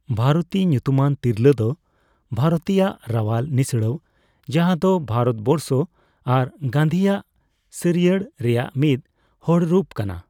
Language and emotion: Santali, neutral